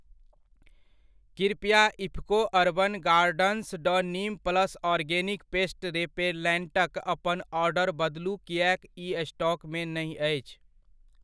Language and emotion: Maithili, neutral